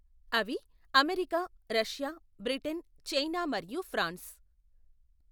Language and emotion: Telugu, neutral